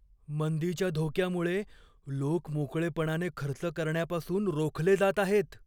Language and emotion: Marathi, fearful